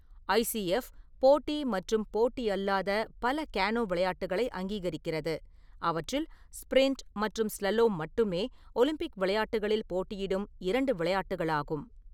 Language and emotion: Tamil, neutral